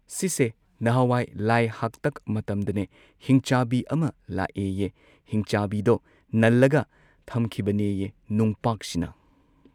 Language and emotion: Manipuri, neutral